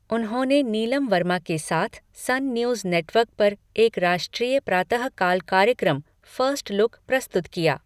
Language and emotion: Hindi, neutral